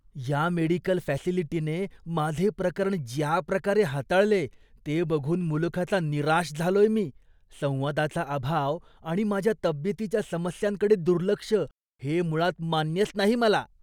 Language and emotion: Marathi, disgusted